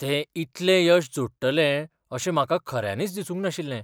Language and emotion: Goan Konkani, surprised